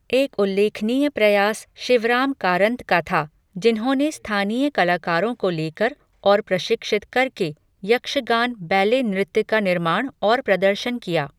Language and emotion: Hindi, neutral